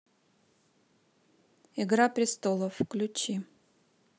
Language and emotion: Russian, neutral